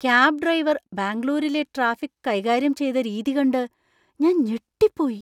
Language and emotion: Malayalam, surprised